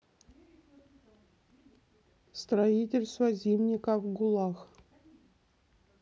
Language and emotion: Russian, neutral